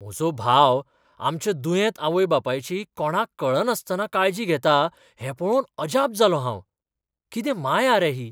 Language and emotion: Goan Konkani, surprised